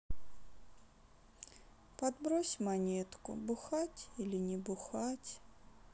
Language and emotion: Russian, sad